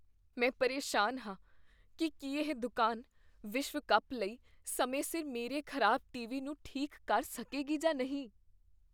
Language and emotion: Punjabi, fearful